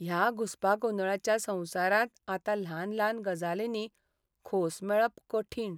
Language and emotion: Goan Konkani, sad